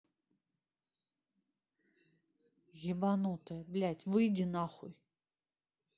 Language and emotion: Russian, angry